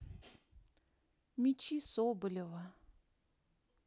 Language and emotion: Russian, sad